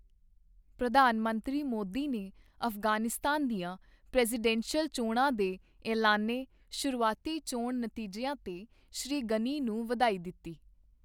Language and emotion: Punjabi, neutral